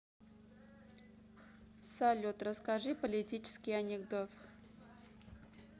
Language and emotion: Russian, neutral